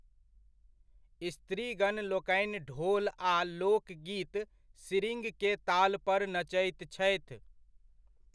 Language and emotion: Maithili, neutral